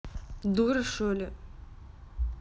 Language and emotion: Russian, angry